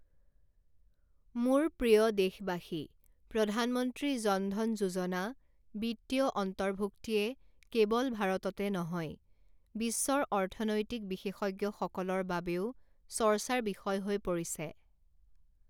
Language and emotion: Assamese, neutral